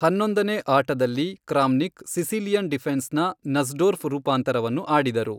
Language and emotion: Kannada, neutral